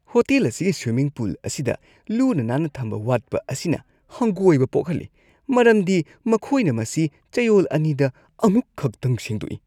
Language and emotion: Manipuri, disgusted